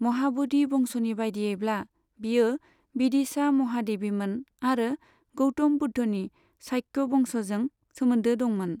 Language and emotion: Bodo, neutral